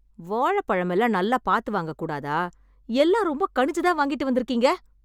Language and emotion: Tamil, angry